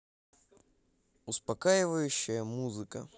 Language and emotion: Russian, neutral